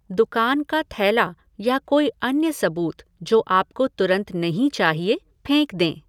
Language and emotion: Hindi, neutral